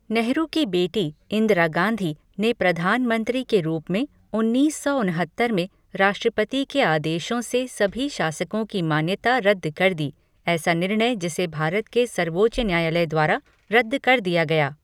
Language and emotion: Hindi, neutral